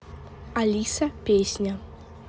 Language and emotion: Russian, neutral